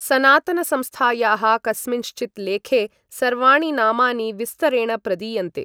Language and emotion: Sanskrit, neutral